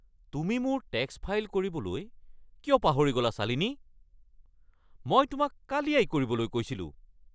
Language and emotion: Assamese, angry